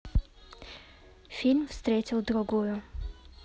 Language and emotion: Russian, neutral